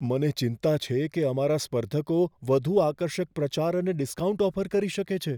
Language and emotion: Gujarati, fearful